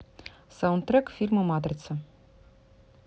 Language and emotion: Russian, neutral